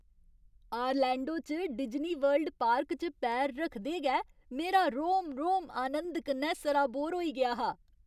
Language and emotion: Dogri, happy